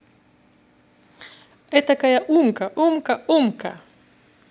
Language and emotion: Russian, positive